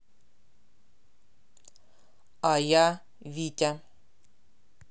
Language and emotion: Russian, neutral